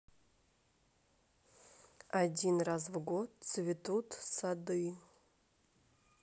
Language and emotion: Russian, neutral